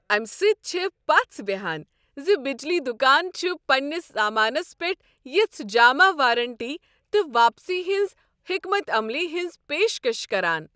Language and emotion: Kashmiri, happy